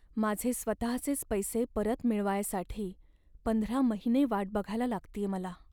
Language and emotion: Marathi, sad